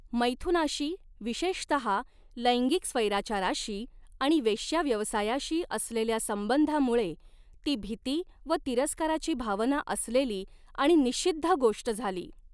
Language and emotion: Marathi, neutral